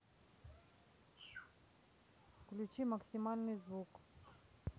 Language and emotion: Russian, neutral